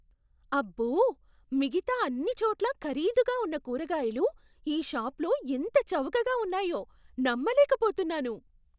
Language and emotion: Telugu, surprised